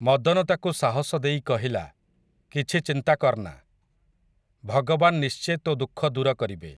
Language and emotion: Odia, neutral